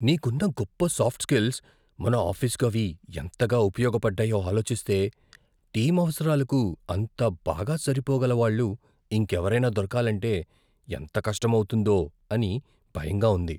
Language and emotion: Telugu, fearful